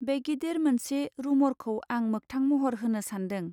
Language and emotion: Bodo, neutral